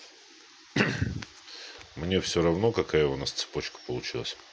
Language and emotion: Russian, neutral